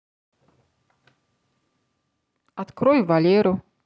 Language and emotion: Russian, neutral